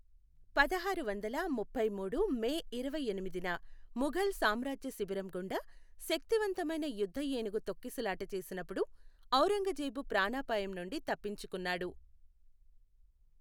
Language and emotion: Telugu, neutral